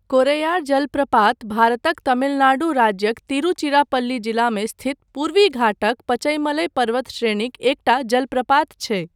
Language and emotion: Maithili, neutral